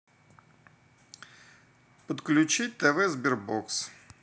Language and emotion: Russian, neutral